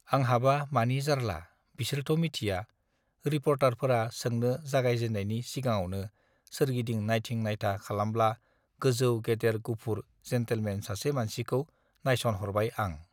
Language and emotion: Bodo, neutral